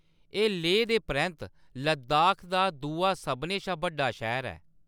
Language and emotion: Dogri, neutral